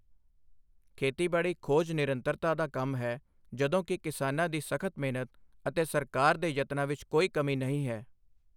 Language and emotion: Punjabi, neutral